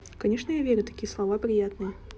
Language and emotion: Russian, neutral